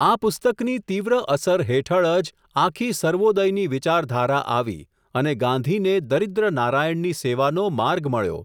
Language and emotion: Gujarati, neutral